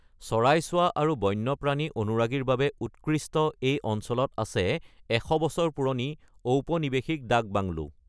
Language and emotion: Assamese, neutral